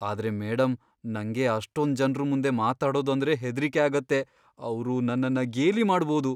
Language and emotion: Kannada, fearful